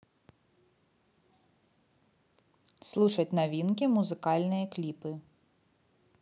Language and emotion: Russian, neutral